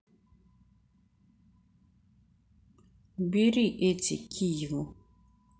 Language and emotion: Russian, neutral